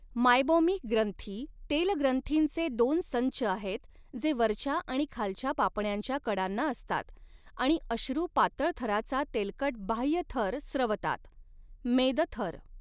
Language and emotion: Marathi, neutral